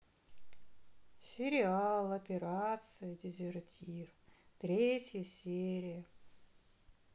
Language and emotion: Russian, sad